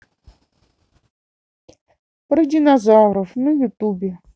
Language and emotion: Russian, neutral